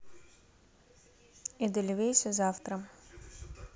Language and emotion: Russian, neutral